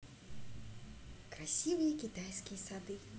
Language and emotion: Russian, positive